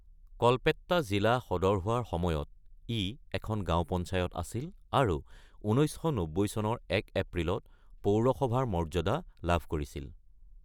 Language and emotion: Assamese, neutral